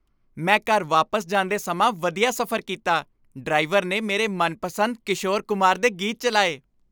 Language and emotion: Punjabi, happy